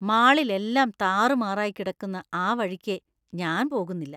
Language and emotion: Malayalam, disgusted